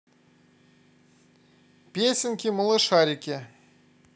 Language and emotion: Russian, positive